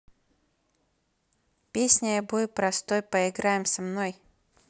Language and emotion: Russian, neutral